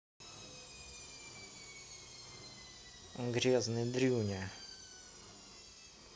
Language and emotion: Russian, angry